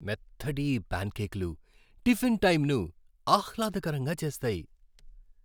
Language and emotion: Telugu, happy